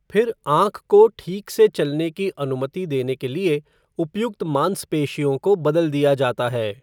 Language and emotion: Hindi, neutral